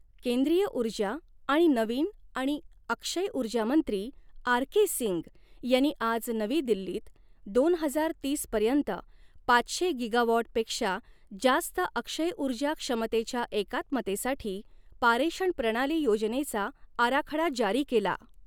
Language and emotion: Marathi, neutral